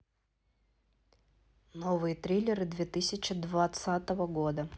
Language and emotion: Russian, neutral